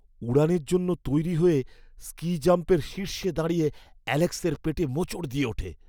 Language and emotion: Bengali, fearful